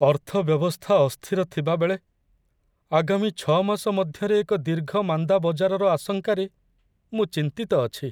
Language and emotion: Odia, sad